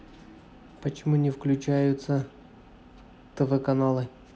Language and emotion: Russian, neutral